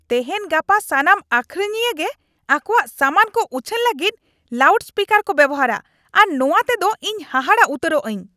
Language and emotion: Santali, angry